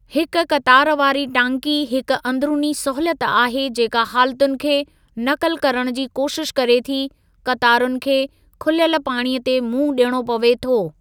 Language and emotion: Sindhi, neutral